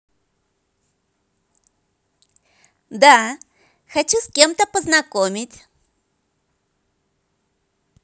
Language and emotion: Russian, positive